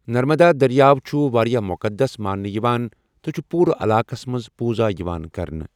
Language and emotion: Kashmiri, neutral